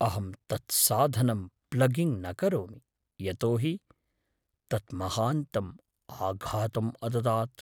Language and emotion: Sanskrit, fearful